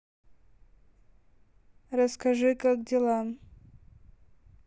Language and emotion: Russian, neutral